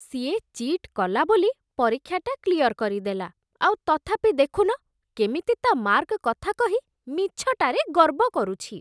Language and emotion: Odia, disgusted